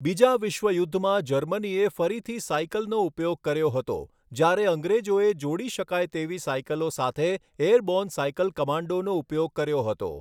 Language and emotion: Gujarati, neutral